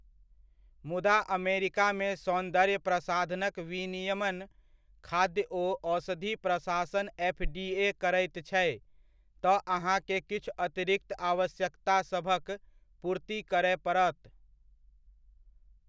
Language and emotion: Maithili, neutral